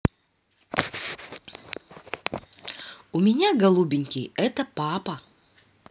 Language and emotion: Russian, positive